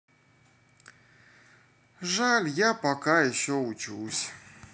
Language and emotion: Russian, sad